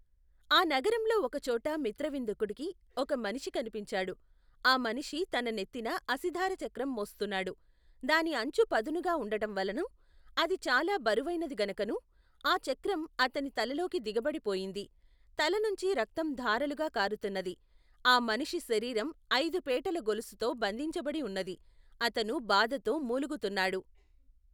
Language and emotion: Telugu, neutral